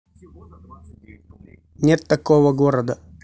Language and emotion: Russian, neutral